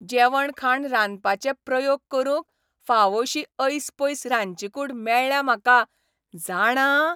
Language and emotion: Goan Konkani, happy